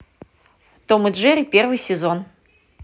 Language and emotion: Russian, positive